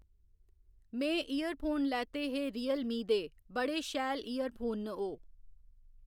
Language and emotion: Dogri, neutral